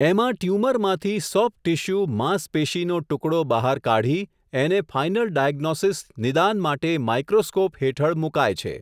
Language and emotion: Gujarati, neutral